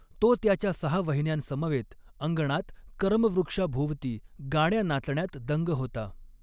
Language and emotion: Marathi, neutral